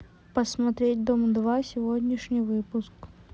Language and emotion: Russian, neutral